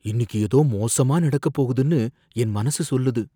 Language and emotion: Tamil, fearful